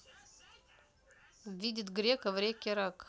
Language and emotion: Russian, neutral